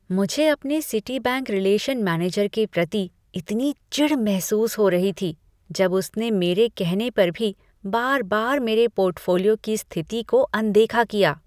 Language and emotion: Hindi, disgusted